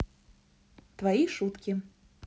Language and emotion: Russian, positive